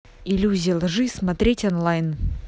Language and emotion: Russian, neutral